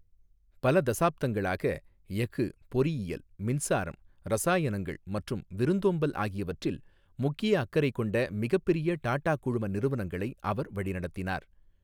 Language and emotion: Tamil, neutral